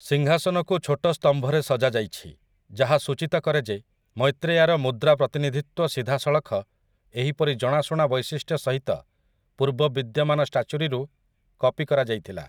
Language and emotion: Odia, neutral